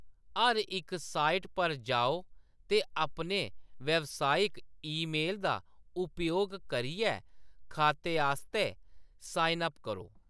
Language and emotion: Dogri, neutral